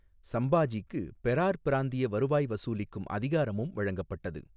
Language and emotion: Tamil, neutral